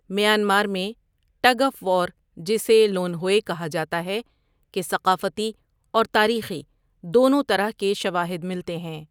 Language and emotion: Urdu, neutral